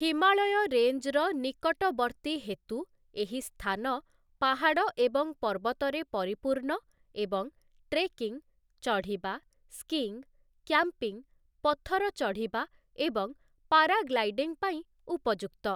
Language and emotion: Odia, neutral